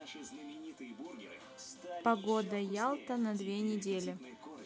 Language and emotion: Russian, neutral